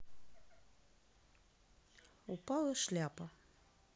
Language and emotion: Russian, neutral